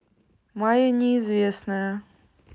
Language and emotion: Russian, neutral